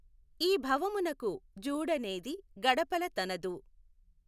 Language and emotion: Telugu, neutral